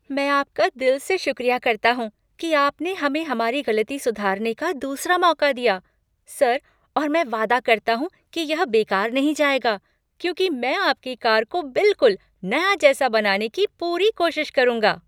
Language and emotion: Hindi, happy